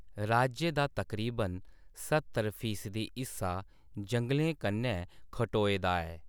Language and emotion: Dogri, neutral